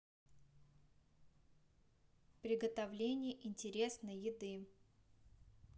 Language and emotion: Russian, neutral